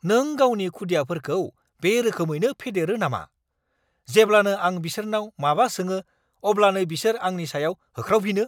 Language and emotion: Bodo, angry